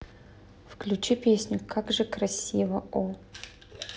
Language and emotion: Russian, neutral